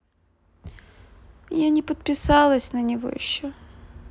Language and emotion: Russian, sad